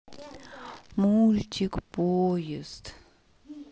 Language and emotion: Russian, sad